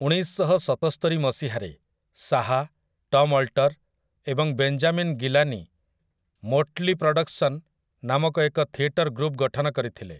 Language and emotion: Odia, neutral